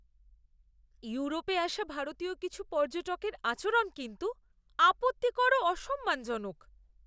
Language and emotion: Bengali, disgusted